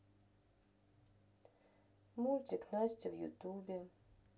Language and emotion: Russian, sad